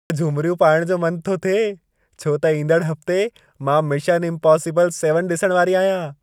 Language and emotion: Sindhi, happy